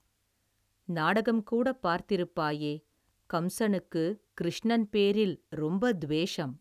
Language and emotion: Tamil, neutral